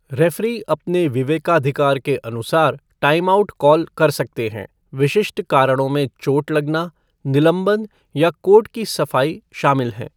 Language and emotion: Hindi, neutral